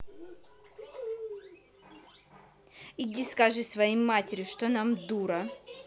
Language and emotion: Russian, angry